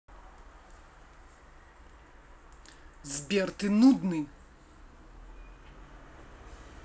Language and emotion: Russian, angry